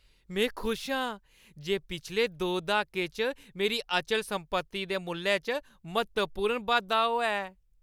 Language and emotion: Dogri, happy